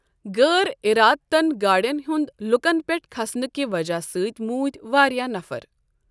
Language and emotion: Kashmiri, neutral